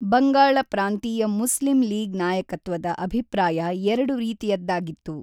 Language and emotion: Kannada, neutral